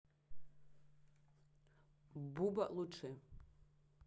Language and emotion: Russian, neutral